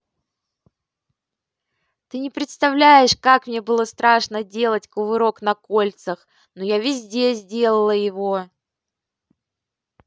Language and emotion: Russian, positive